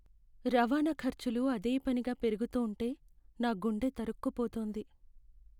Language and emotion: Telugu, sad